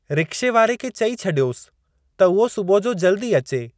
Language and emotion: Sindhi, neutral